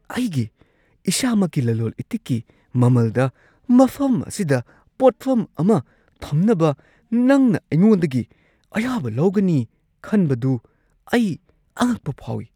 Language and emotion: Manipuri, surprised